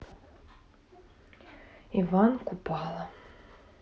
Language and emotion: Russian, sad